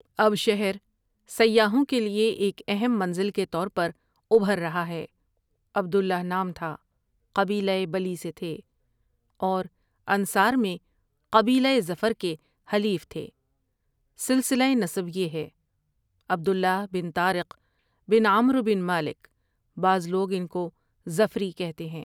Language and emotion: Urdu, neutral